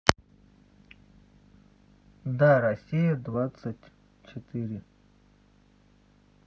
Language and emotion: Russian, neutral